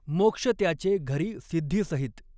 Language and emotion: Marathi, neutral